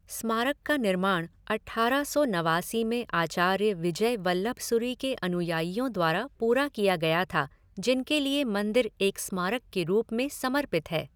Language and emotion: Hindi, neutral